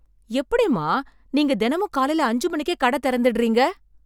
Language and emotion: Tamil, surprised